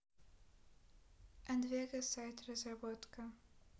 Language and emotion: Russian, neutral